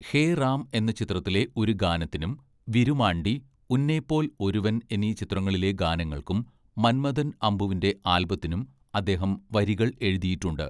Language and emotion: Malayalam, neutral